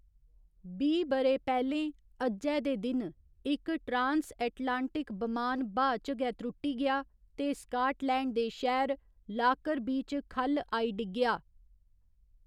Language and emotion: Dogri, neutral